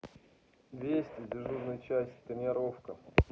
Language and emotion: Russian, neutral